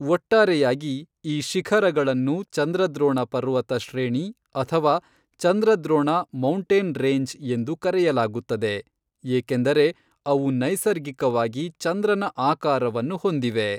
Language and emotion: Kannada, neutral